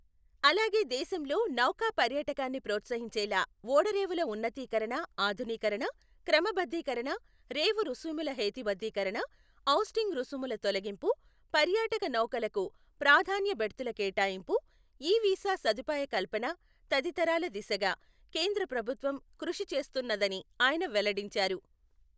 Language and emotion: Telugu, neutral